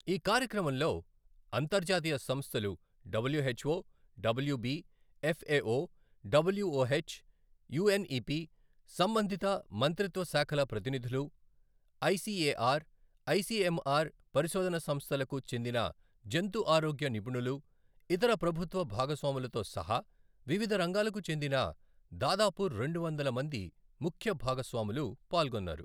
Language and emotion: Telugu, neutral